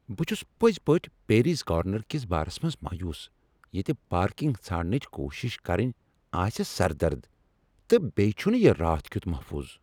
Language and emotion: Kashmiri, angry